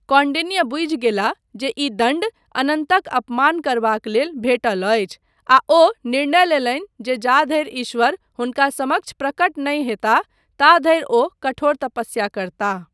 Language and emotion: Maithili, neutral